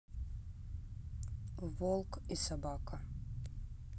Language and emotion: Russian, neutral